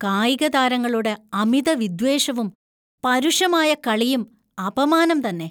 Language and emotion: Malayalam, disgusted